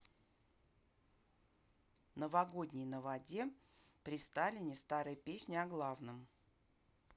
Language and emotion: Russian, neutral